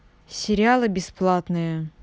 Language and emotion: Russian, neutral